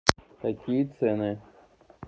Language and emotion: Russian, neutral